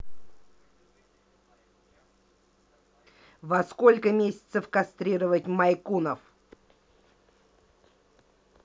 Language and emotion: Russian, angry